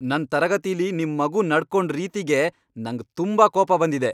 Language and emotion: Kannada, angry